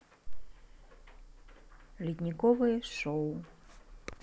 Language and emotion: Russian, neutral